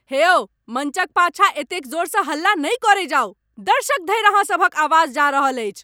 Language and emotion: Maithili, angry